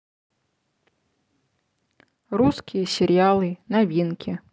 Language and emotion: Russian, neutral